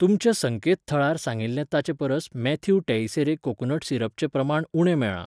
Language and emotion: Goan Konkani, neutral